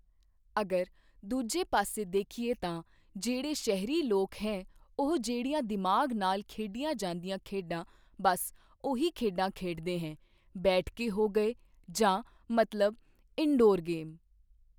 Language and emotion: Punjabi, neutral